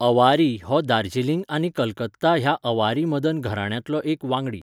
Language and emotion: Goan Konkani, neutral